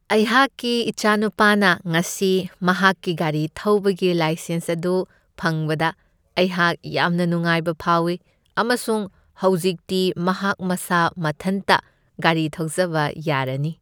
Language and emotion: Manipuri, happy